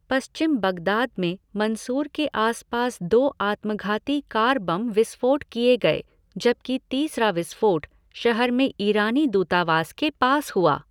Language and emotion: Hindi, neutral